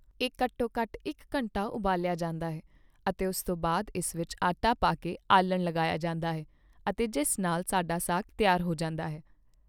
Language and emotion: Punjabi, neutral